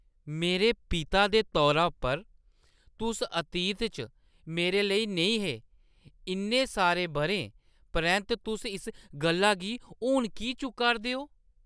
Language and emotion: Dogri, surprised